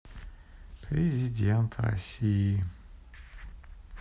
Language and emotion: Russian, sad